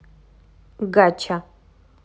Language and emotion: Russian, neutral